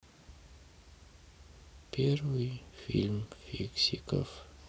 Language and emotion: Russian, sad